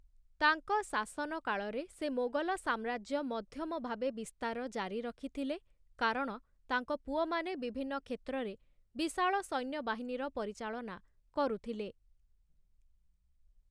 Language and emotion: Odia, neutral